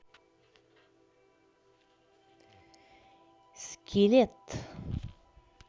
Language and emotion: Russian, neutral